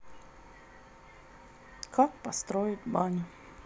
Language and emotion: Russian, neutral